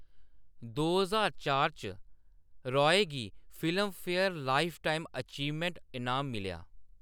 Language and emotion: Dogri, neutral